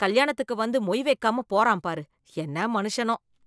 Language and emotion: Tamil, disgusted